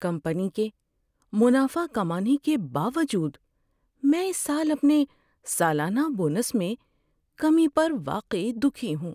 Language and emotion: Urdu, sad